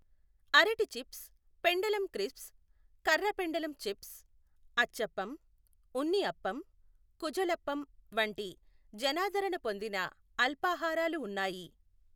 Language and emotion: Telugu, neutral